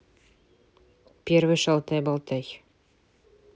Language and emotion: Russian, neutral